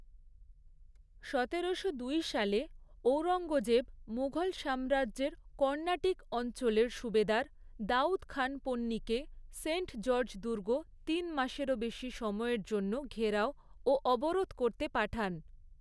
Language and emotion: Bengali, neutral